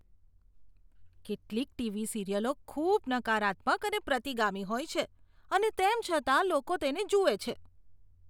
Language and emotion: Gujarati, disgusted